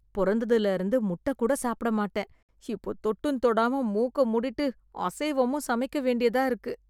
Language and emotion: Tamil, disgusted